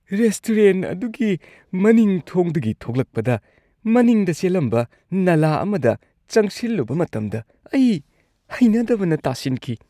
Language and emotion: Manipuri, disgusted